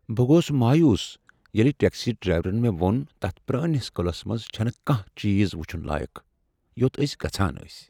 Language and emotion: Kashmiri, sad